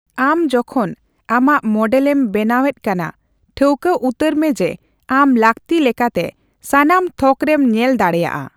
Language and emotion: Santali, neutral